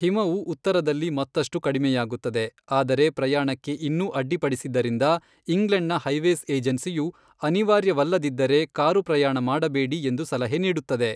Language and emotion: Kannada, neutral